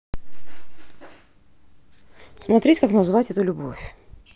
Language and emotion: Russian, neutral